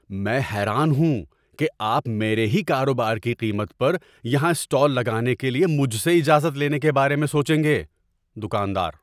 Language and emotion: Urdu, surprised